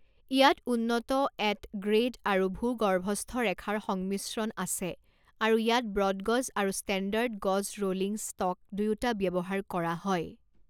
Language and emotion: Assamese, neutral